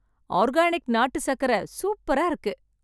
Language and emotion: Tamil, happy